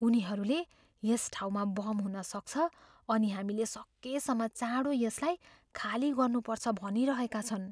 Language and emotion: Nepali, fearful